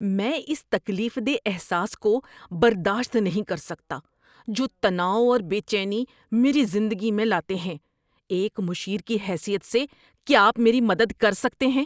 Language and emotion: Urdu, disgusted